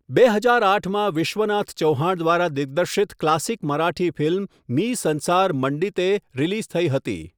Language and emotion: Gujarati, neutral